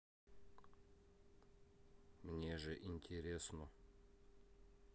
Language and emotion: Russian, neutral